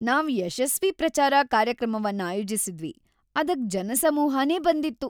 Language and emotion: Kannada, happy